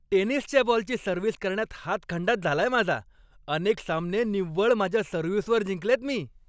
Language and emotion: Marathi, happy